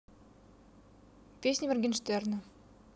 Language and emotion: Russian, neutral